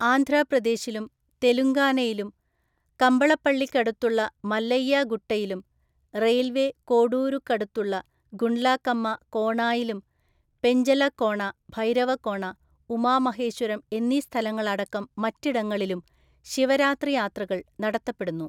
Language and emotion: Malayalam, neutral